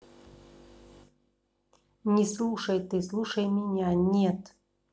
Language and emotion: Russian, angry